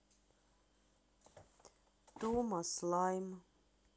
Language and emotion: Russian, sad